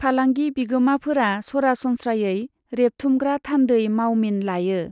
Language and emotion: Bodo, neutral